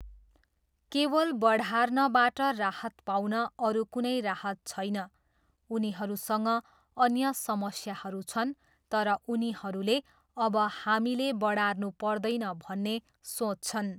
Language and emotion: Nepali, neutral